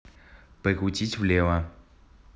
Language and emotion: Russian, neutral